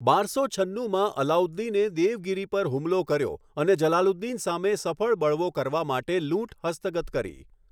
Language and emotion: Gujarati, neutral